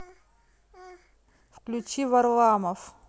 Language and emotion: Russian, neutral